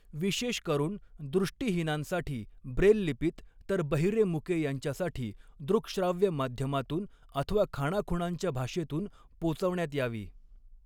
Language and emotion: Marathi, neutral